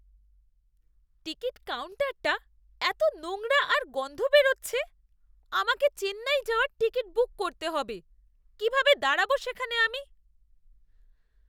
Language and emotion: Bengali, disgusted